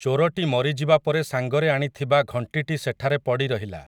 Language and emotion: Odia, neutral